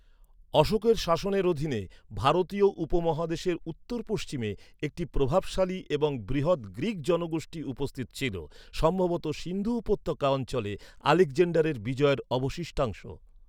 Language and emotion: Bengali, neutral